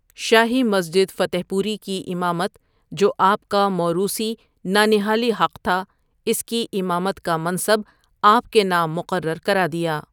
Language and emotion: Urdu, neutral